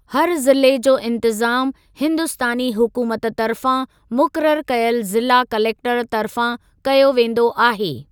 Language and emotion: Sindhi, neutral